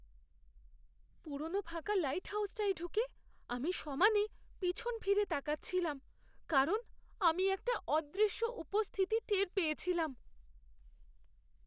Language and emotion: Bengali, fearful